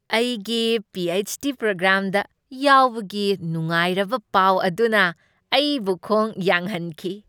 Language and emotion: Manipuri, happy